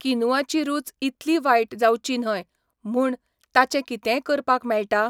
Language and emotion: Goan Konkani, neutral